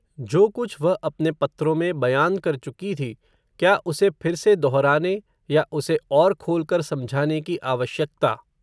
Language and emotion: Hindi, neutral